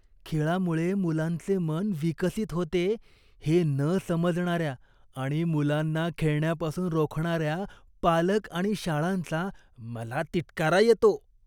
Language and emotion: Marathi, disgusted